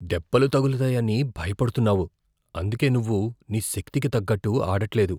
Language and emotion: Telugu, fearful